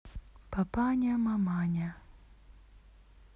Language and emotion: Russian, neutral